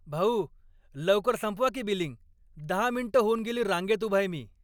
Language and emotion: Marathi, angry